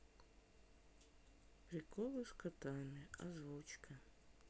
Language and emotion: Russian, sad